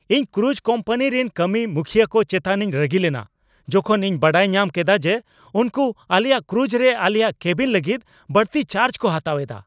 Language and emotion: Santali, angry